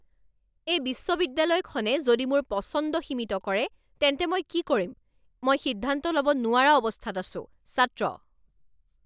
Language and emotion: Assamese, angry